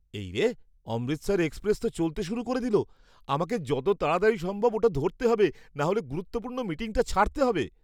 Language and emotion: Bengali, surprised